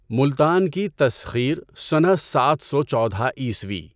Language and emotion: Urdu, neutral